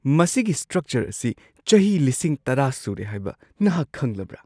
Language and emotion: Manipuri, surprised